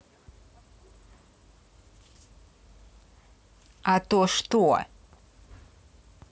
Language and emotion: Russian, angry